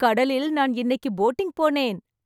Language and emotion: Tamil, happy